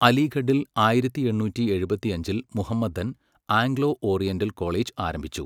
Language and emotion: Malayalam, neutral